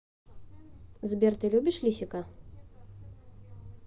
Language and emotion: Russian, neutral